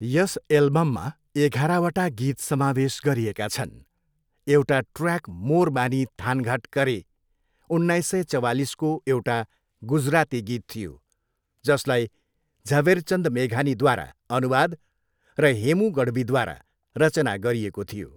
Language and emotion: Nepali, neutral